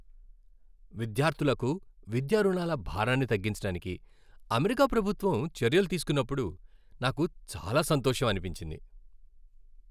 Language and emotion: Telugu, happy